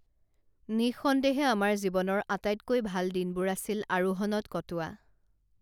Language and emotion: Assamese, neutral